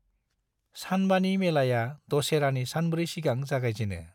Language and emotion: Bodo, neutral